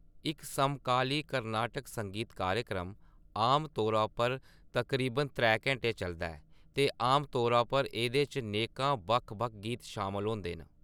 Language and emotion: Dogri, neutral